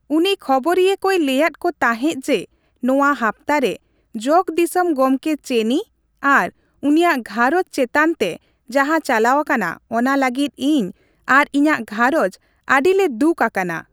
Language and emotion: Santali, neutral